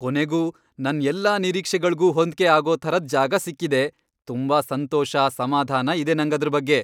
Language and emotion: Kannada, happy